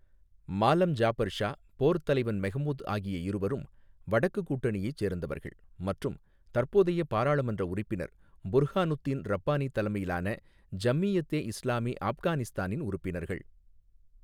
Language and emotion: Tamil, neutral